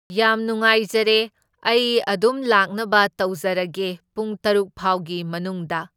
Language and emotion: Manipuri, neutral